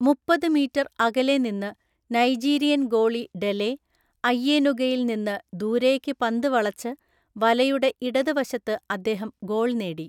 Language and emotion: Malayalam, neutral